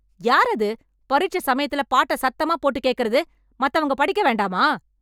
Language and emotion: Tamil, angry